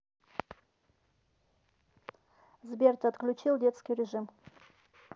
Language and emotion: Russian, neutral